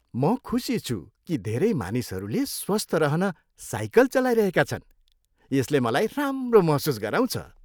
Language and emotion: Nepali, happy